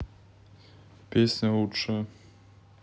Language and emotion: Russian, neutral